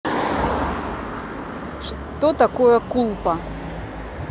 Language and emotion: Russian, neutral